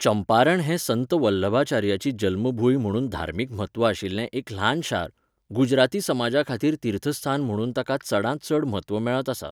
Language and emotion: Goan Konkani, neutral